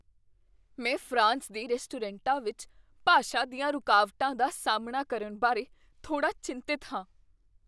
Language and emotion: Punjabi, fearful